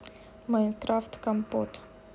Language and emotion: Russian, neutral